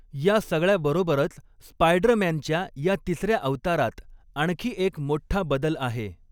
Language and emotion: Marathi, neutral